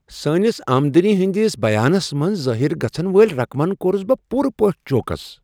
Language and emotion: Kashmiri, surprised